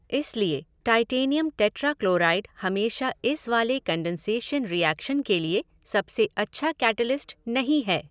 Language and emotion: Hindi, neutral